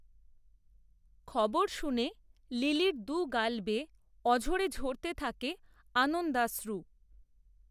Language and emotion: Bengali, neutral